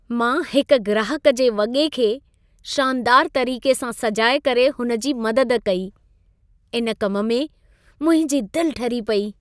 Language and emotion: Sindhi, happy